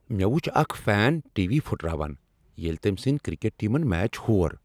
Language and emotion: Kashmiri, angry